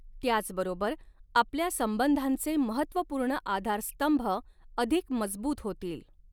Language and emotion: Marathi, neutral